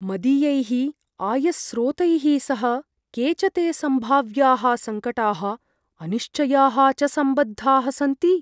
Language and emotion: Sanskrit, fearful